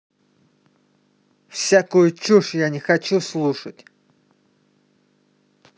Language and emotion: Russian, angry